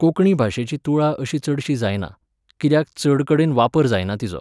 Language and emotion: Goan Konkani, neutral